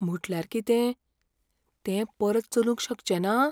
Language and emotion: Goan Konkani, fearful